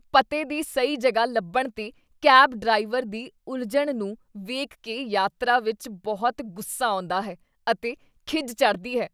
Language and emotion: Punjabi, disgusted